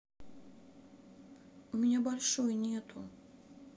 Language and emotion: Russian, sad